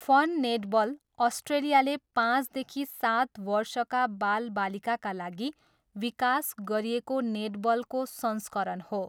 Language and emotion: Nepali, neutral